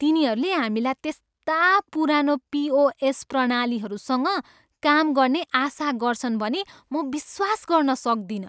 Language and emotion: Nepali, disgusted